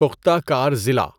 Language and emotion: Urdu, neutral